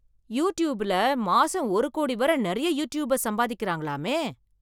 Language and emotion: Tamil, surprised